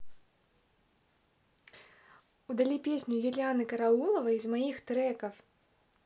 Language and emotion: Russian, positive